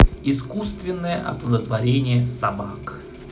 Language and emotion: Russian, positive